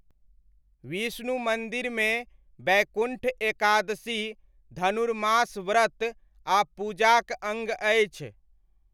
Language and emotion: Maithili, neutral